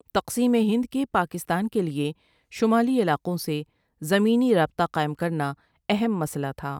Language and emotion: Urdu, neutral